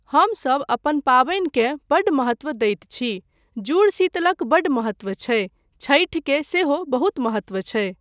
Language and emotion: Maithili, neutral